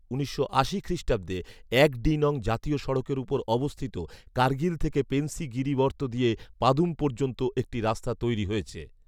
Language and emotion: Bengali, neutral